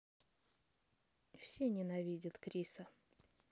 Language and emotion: Russian, neutral